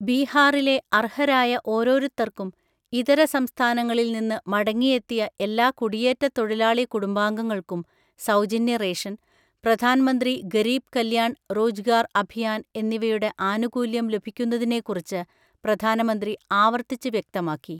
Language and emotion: Malayalam, neutral